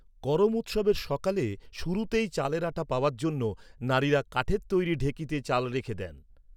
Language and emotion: Bengali, neutral